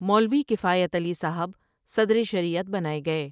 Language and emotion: Urdu, neutral